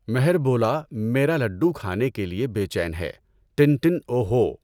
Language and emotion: Urdu, neutral